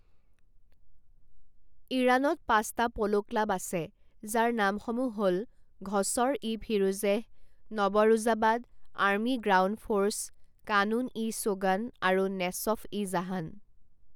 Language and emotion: Assamese, neutral